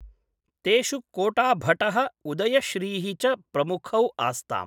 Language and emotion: Sanskrit, neutral